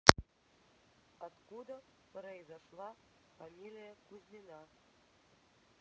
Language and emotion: Russian, neutral